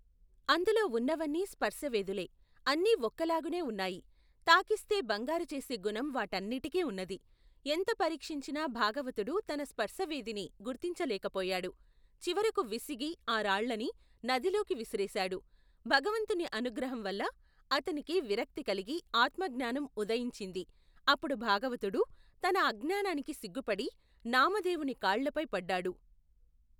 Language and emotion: Telugu, neutral